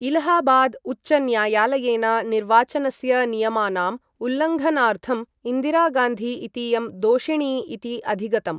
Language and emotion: Sanskrit, neutral